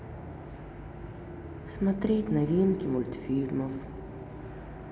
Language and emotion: Russian, sad